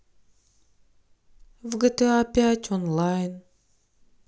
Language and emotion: Russian, sad